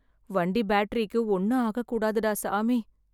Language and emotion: Tamil, sad